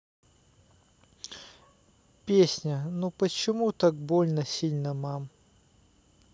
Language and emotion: Russian, sad